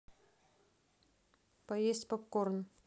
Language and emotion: Russian, neutral